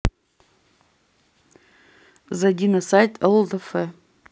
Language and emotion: Russian, neutral